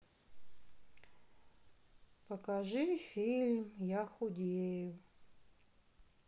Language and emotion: Russian, sad